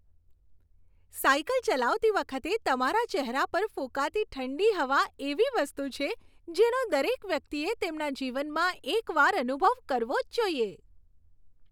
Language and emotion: Gujarati, happy